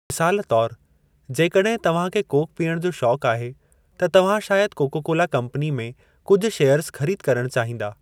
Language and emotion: Sindhi, neutral